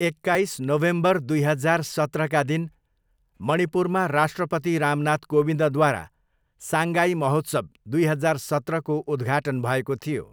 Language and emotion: Nepali, neutral